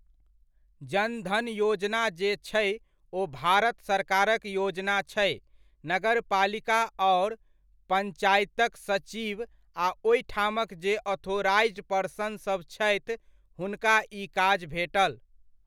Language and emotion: Maithili, neutral